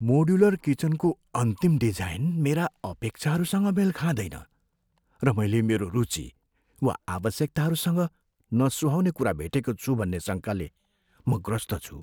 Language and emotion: Nepali, fearful